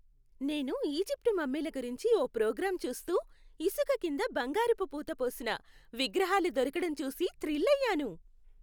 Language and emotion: Telugu, happy